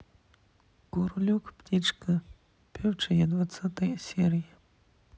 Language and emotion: Russian, neutral